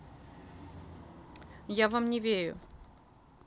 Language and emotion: Russian, neutral